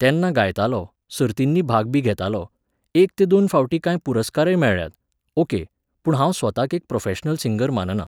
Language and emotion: Goan Konkani, neutral